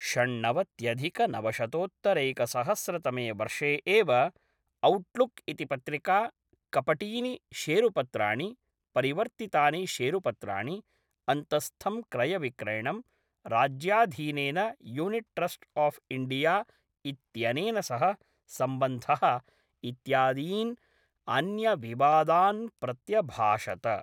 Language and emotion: Sanskrit, neutral